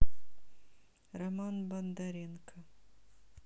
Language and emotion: Russian, neutral